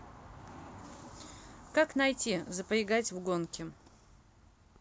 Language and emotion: Russian, neutral